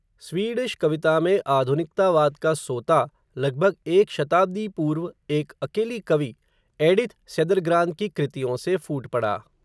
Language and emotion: Hindi, neutral